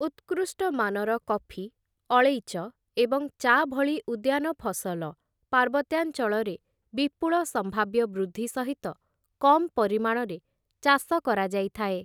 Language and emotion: Odia, neutral